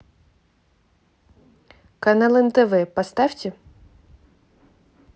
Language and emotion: Russian, neutral